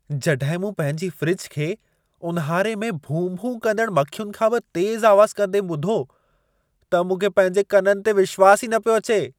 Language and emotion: Sindhi, surprised